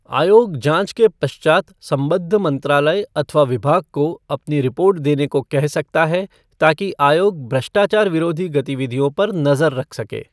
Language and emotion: Hindi, neutral